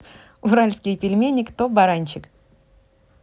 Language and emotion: Russian, positive